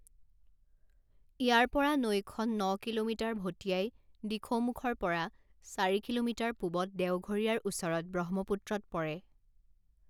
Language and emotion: Assamese, neutral